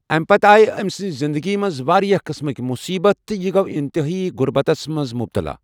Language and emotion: Kashmiri, neutral